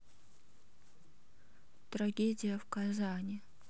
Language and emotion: Russian, sad